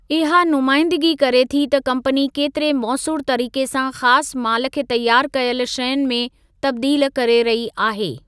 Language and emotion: Sindhi, neutral